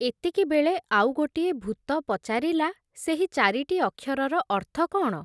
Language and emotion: Odia, neutral